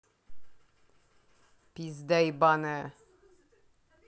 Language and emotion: Russian, angry